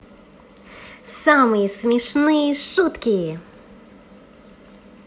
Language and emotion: Russian, positive